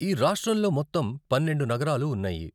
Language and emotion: Telugu, neutral